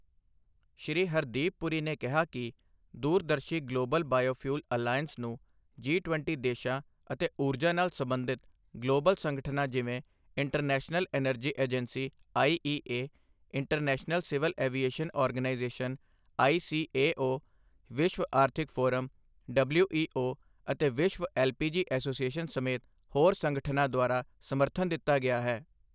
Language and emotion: Punjabi, neutral